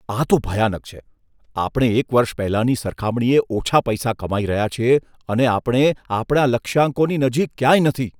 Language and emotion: Gujarati, disgusted